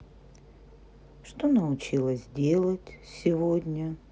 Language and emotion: Russian, sad